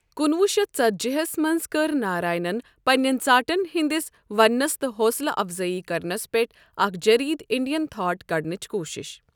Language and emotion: Kashmiri, neutral